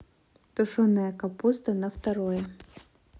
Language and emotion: Russian, neutral